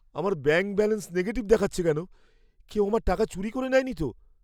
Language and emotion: Bengali, fearful